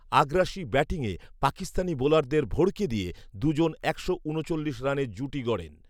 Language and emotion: Bengali, neutral